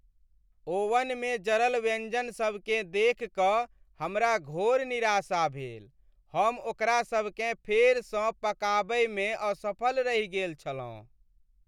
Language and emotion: Maithili, sad